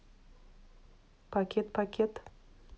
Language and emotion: Russian, neutral